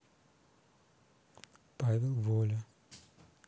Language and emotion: Russian, sad